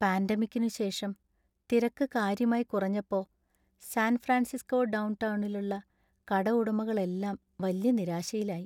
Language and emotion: Malayalam, sad